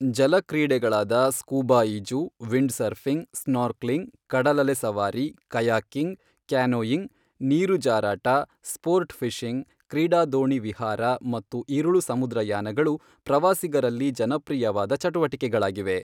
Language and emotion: Kannada, neutral